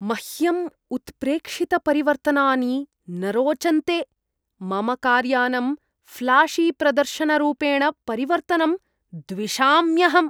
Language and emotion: Sanskrit, disgusted